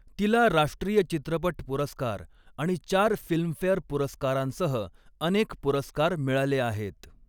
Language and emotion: Marathi, neutral